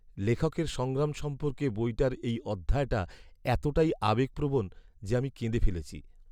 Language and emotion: Bengali, sad